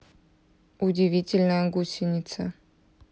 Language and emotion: Russian, neutral